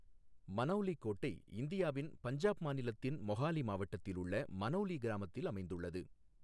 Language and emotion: Tamil, neutral